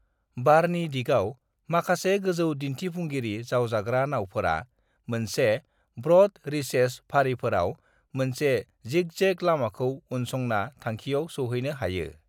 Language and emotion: Bodo, neutral